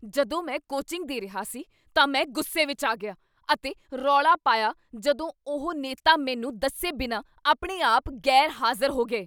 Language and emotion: Punjabi, angry